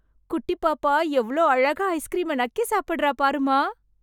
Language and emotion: Tamil, happy